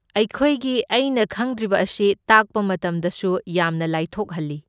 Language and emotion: Manipuri, neutral